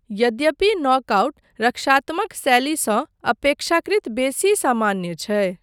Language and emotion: Maithili, neutral